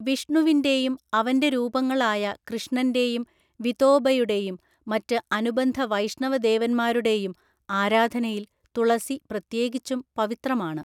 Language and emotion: Malayalam, neutral